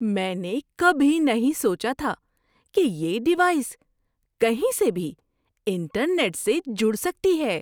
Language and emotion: Urdu, surprised